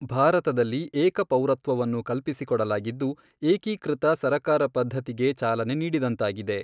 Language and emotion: Kannada, neutral